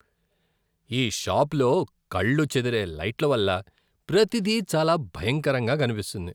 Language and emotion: Telugu, disgusted